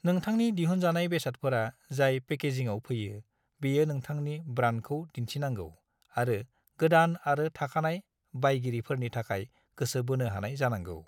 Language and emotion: Bodo, neutral